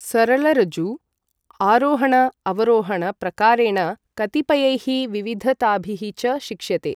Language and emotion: Sanskrit, neutral